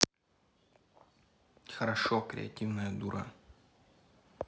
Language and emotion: Russian, neutral